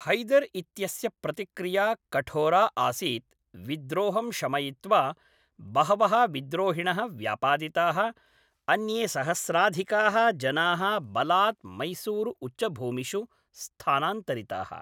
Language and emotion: Sanskrit, neutral